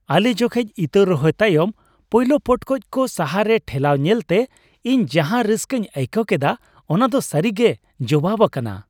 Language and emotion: Santali, happy